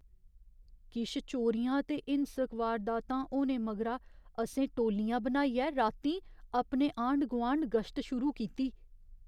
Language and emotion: Dogri, fearful